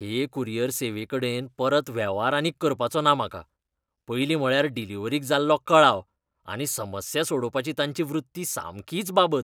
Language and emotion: Goan Konkani, disgusted